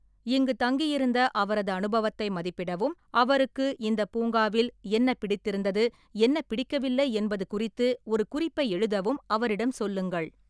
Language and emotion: Tamil, neutral